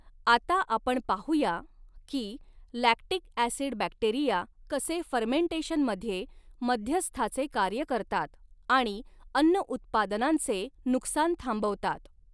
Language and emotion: Marathi, neutral